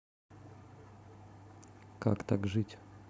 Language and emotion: Russian, neutral